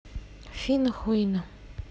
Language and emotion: Russian, neutral